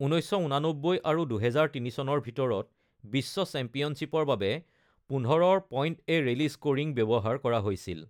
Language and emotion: Assamese, neutral